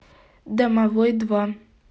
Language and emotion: Russian, neutral